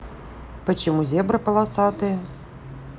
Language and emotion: Russian, neutral